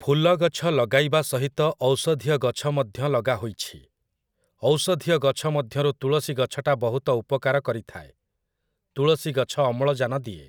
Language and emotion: Odia, neutral